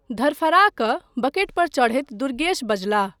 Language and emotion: Maithili, neutral